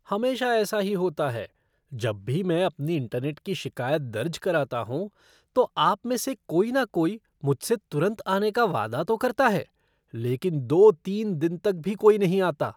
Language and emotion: Hindi, disgusted